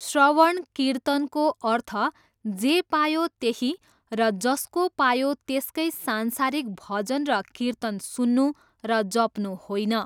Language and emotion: Nepali, neutral